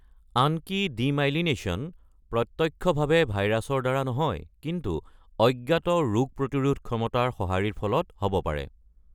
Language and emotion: Assamese, neutral